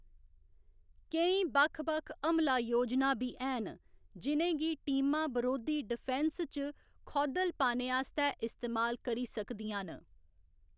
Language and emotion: Dogri, neutral